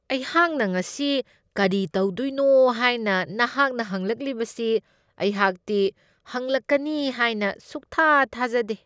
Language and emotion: Manipuri, disgusted